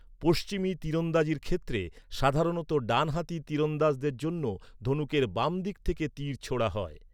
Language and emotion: Bengali, neutral